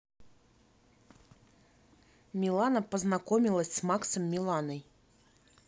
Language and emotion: Russian, neutral